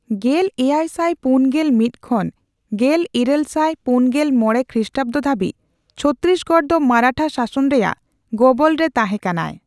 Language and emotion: Santali, neutral